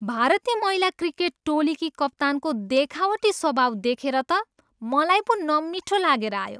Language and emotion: Nepali, disgusted